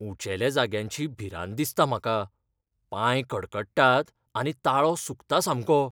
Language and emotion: Goan Konkani, fearful